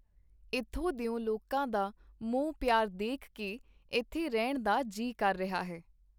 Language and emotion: Punjabi, neutral